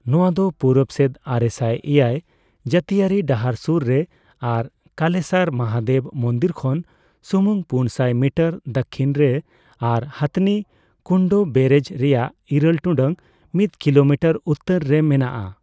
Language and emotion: Santali, neutral